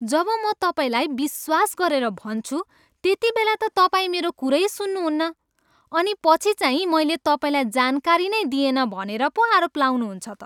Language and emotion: Nepali, disgusted